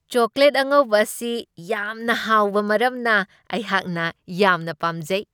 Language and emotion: Manipuri, happy